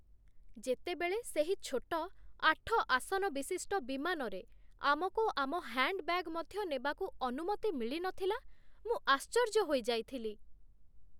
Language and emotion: Odia, surprised